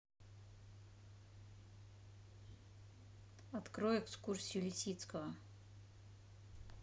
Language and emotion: Russian, neutral